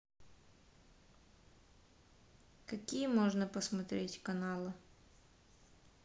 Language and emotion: Russian, neutral